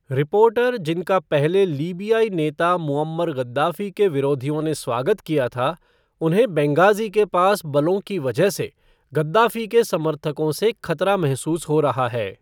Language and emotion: Hindi, neutral